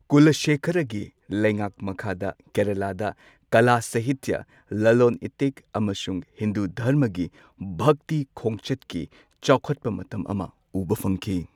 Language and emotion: Manipuri, neutral